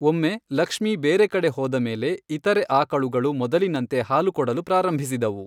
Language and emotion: Kannada, neutral